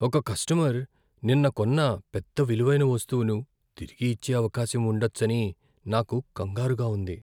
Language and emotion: Telugu, fearful